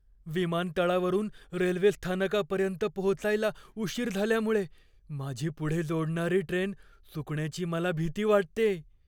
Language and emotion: Marathi, fearful